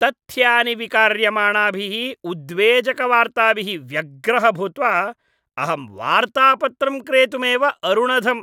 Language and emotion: Sanskrit, disgusted